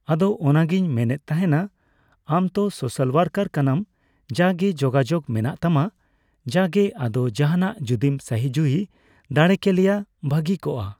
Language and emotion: Santali, neutral